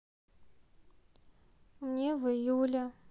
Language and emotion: Russian, neutral